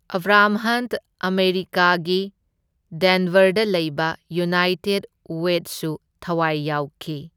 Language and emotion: Manipuri, neutral